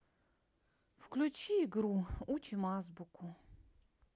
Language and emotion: Russian, sad